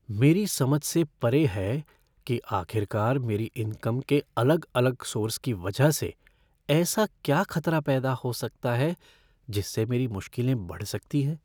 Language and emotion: Hindi, fearful